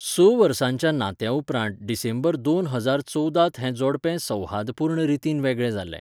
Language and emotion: Goan Konkani, neutral